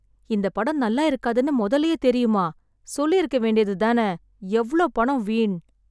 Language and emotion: Tamil, sad